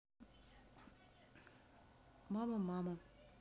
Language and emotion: Russian, sad